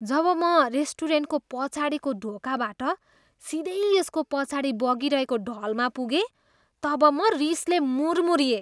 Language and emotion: Nepali, disgusted